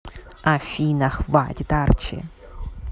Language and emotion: Russian, neutral